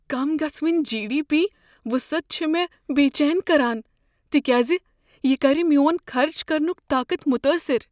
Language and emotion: Kashmiri, fearful